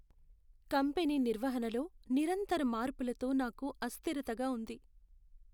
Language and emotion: Telugu, sad